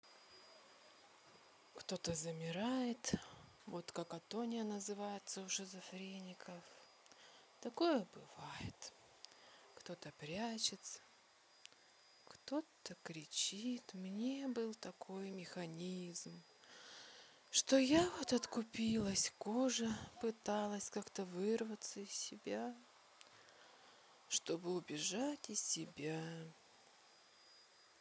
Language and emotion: Russian, sad